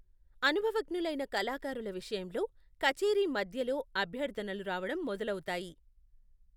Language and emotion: Telugu, neutral